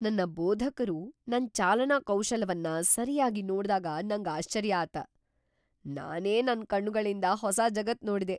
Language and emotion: Kannada, surprised